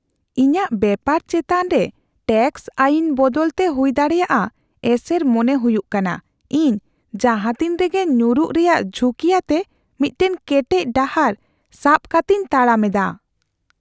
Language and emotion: Santali, fearful